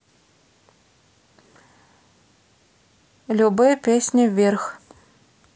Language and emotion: Russian, neutral